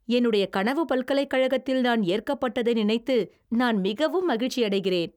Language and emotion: Tamil, happy